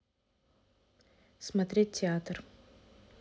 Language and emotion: Russian, neutral